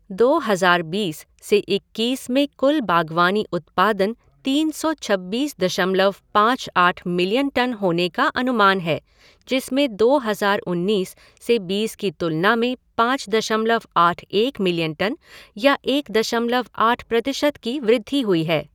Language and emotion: Hindi, neutral